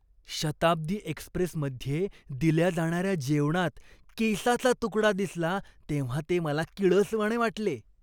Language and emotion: Marathi, disgusted